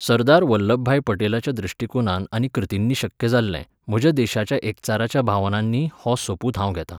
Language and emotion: Goan Konkani, neutral